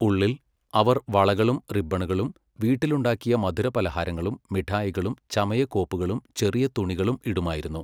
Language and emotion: Malayalam, neutral